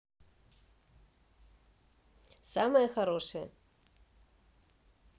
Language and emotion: Russian, positive